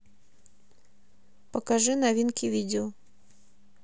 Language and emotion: Russian, neutral